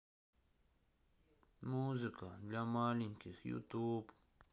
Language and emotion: Russian, sad